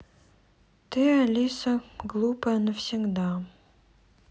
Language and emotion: Russian, sad